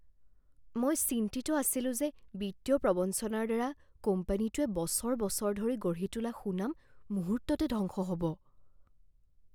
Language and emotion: Assamese, fearful